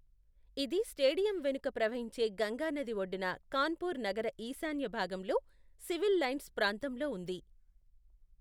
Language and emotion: Telugu, neutral